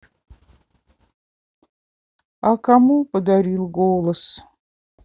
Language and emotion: Russian, sad